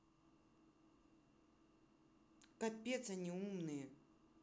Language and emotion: Russian, angry